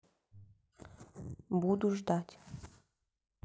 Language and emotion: Russian, neutral